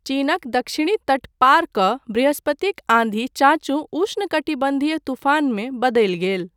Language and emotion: Maithili, neutral